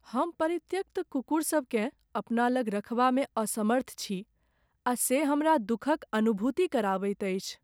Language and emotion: Maithili, sad